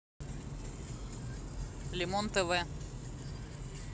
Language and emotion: Russian, neutral